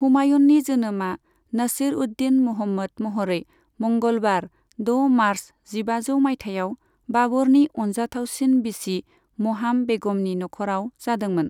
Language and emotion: Bodo, neutral